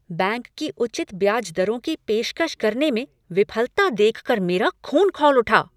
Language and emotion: Hindi, angry